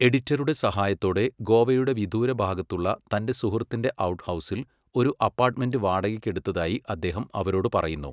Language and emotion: Malayalam, neutral